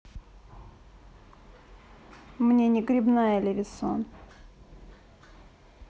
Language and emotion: Russian, neutral